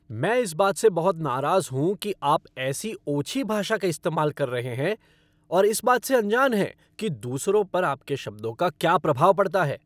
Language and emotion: Hindi, angry